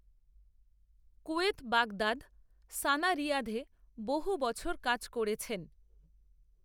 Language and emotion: Bengali, neutral